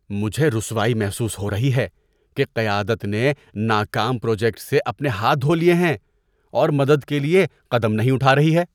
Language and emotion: Urdu, disgusted